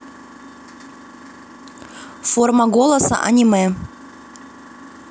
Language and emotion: Russian, neutral